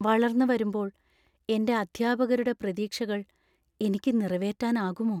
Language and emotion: Malayalam, fearful